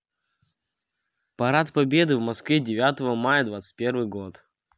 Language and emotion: Russian, neutral